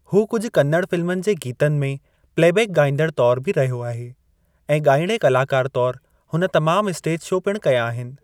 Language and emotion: Sindhi, neutral